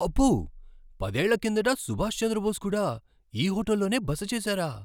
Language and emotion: Telugu, surprised